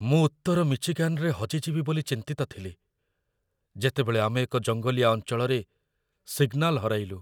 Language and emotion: Odia, fearful